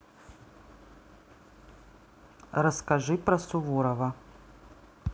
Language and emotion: Russian, neutral